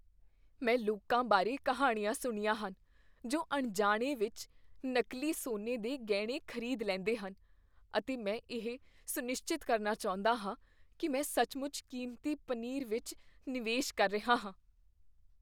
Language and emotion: Punjabi, fearful